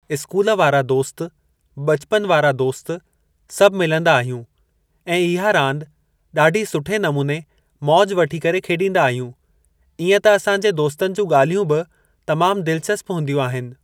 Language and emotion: Sindhi, neutral